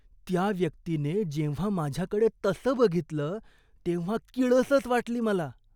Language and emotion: Marathi, disgusted